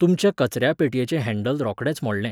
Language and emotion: Goan Konkani, neutral